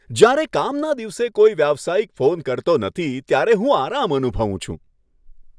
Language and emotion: Gujarati, happy